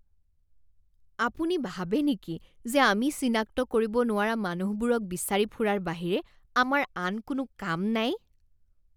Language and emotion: Assamese, disgusted